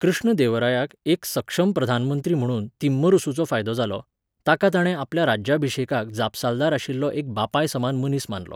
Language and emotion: Goan Konkani, neutral